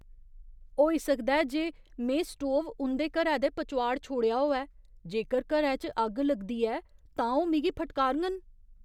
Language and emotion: Dogri, fearful